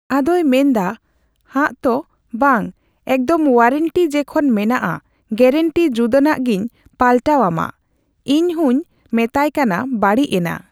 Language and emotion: Santali, neutral